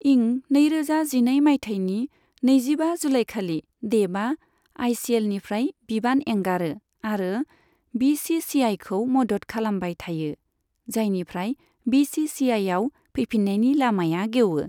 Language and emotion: Bodo, neutral